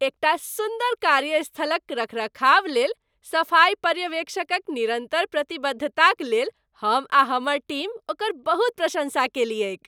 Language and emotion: Maithili, happy